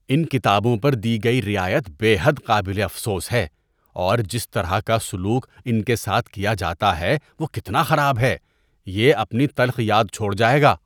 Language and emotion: Urdu, disgusted